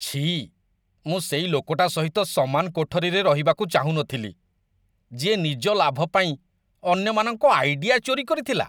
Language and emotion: Odia, disgusted